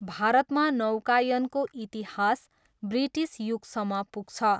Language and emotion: Nepali, neutral